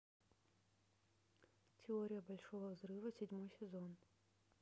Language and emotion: Russian, neutral